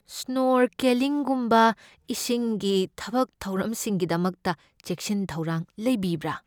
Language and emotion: Manipuri, fearful